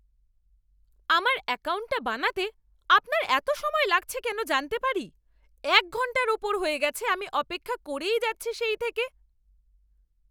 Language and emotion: Bengali, angry